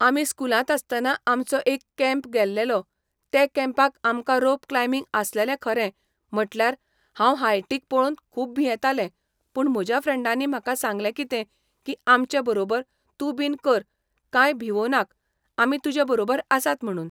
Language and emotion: Goan Konkani, neutral